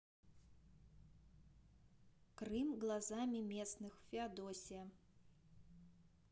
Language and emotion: Russian, neutral